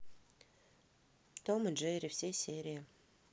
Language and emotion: Russian, neutral